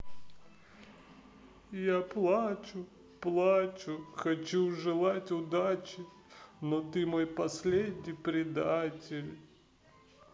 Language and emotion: Russian, sad